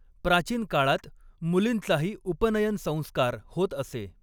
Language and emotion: Marathi, neutral